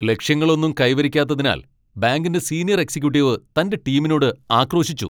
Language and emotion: Malayalam, angry